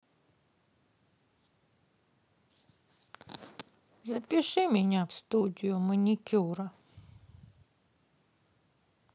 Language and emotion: Russian, sad